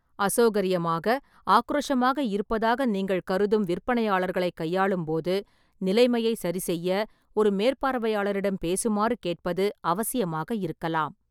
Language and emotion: Tamil, neutral